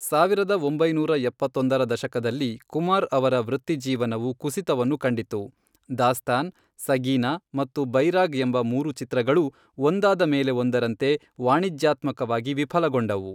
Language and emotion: Kannada, neutral